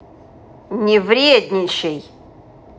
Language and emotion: Russian, angry